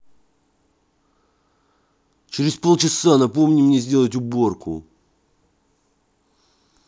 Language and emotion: Russian, angry